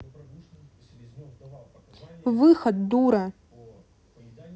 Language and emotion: Russian, angry